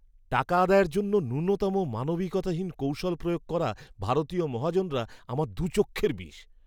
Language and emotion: Bengali, disgusted